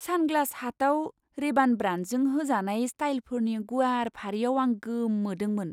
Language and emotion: Bodo, surprised